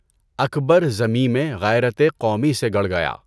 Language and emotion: Urdu, neutral